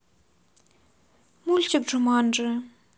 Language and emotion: Russian, neutral